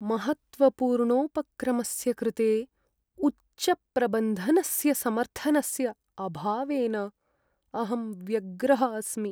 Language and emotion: Sanskrit, sad